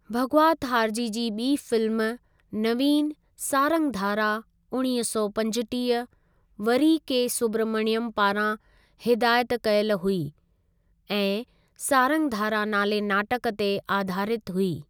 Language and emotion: Sindhi, neutral